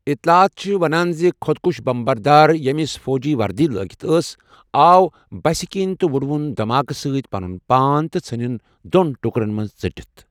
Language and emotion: Kashmiri, neutral